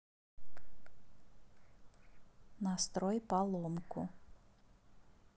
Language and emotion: Russian, neutral